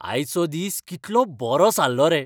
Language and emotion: Goan Konkani, happy